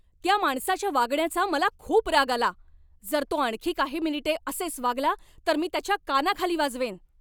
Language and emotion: Marathi, angry